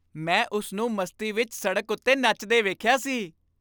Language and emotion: Punjabi, happy